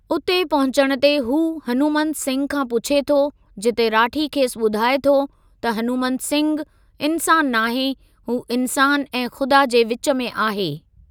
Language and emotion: Sindhi, neutral